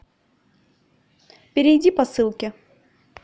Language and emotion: Russian, neutral